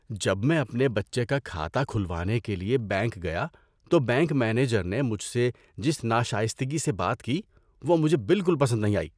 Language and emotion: Urdu, disgusted